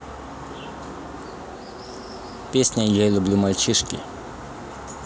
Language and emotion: Russian, neutral